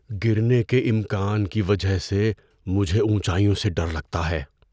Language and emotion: Urdu, fearful